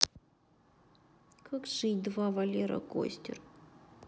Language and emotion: Russian, sad